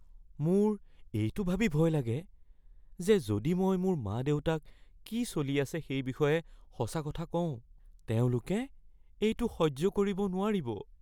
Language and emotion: Assamese, fearful